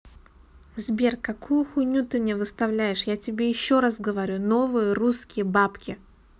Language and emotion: Russian, angry